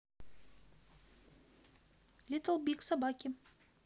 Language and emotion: Russian, neutral